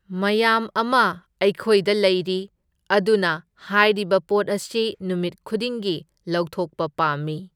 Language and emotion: Manipuri, neutral